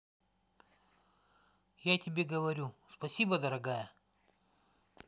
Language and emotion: Russian, neutral